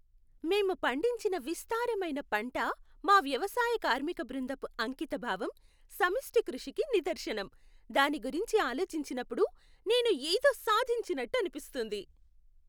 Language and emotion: Telugu, happy